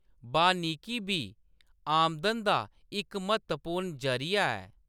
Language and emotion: Dogri, neutral